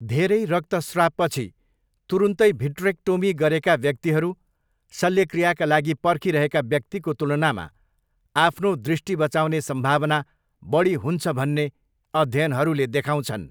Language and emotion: Nepali, neutral